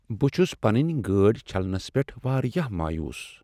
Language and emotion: Kashmiri, sad